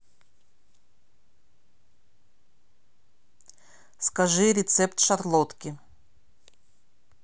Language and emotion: Russian, neutral